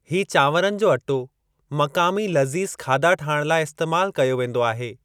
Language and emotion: Sindhi, neutral